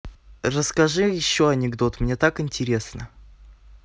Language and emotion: Russian, positive